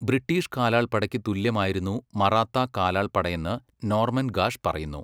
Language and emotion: Malayalam, neutral